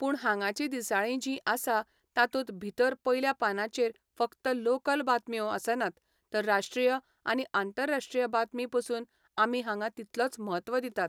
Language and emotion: Goan Konkani, neutral